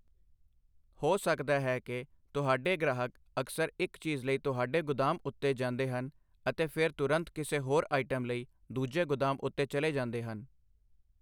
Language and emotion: Punjabi, neutral